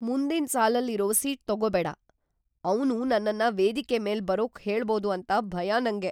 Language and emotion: Kannada, fearful